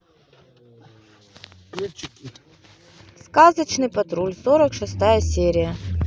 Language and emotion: Russian, neutral